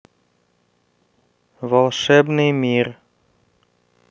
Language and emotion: Russian, neutral